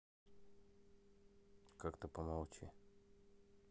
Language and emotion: Russian, neutral